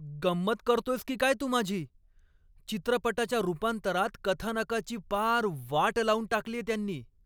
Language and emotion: Marathi, angry